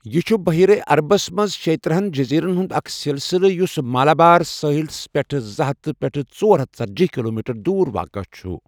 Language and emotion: Kashmiri, neutral